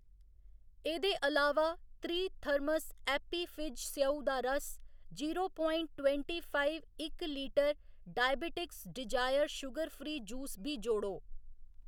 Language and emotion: Dogri, neutral